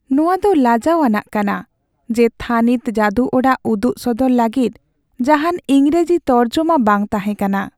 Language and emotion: Santali, sad